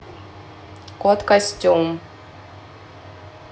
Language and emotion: Russian, neutral